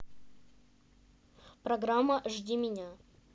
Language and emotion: Russian, neutral